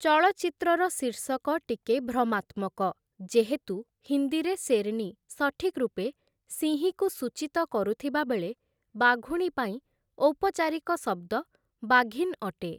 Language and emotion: Odia, neutral